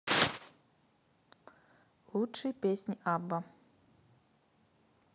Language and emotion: Russian, neutral